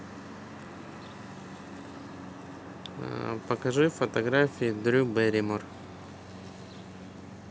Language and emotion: Russian, neutral